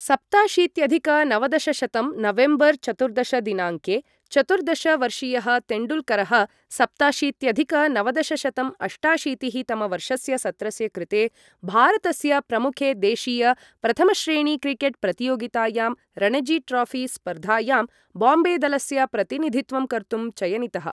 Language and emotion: Sanskrit, neutral